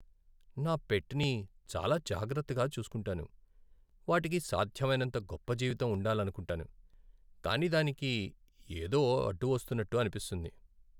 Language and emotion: Telugu, sad